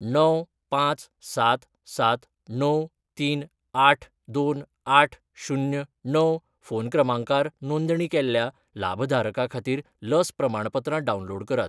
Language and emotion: Goan Konkani, neutral